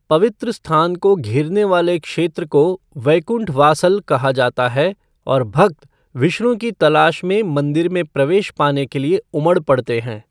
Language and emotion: Hindi, neutral